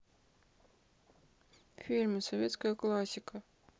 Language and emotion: Russian, sad